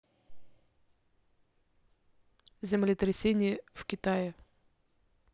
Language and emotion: Russian, neutral